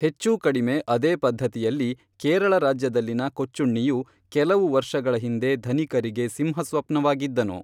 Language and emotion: Kannada, neutral